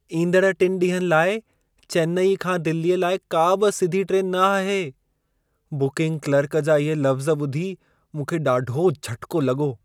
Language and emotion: Sindhi, surprised